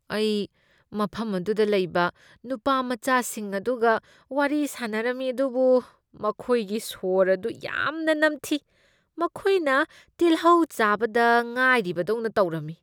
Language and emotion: Manipuri, disgusted